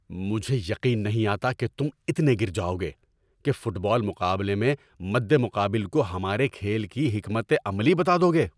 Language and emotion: Urdu, angry